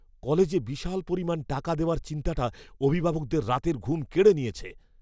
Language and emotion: Bengali, fearful